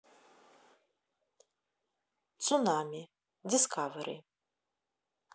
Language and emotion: Russian, neutral